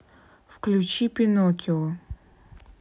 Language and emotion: Russian, neutral